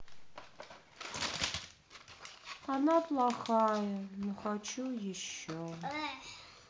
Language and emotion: Russian, sad